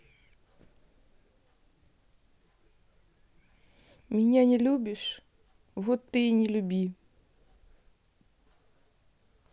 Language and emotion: Russian, sad